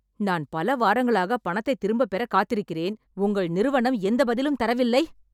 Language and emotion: Tamil, angry